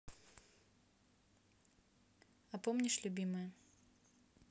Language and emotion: Russian, neutral